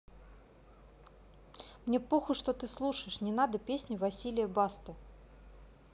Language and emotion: Russian, angry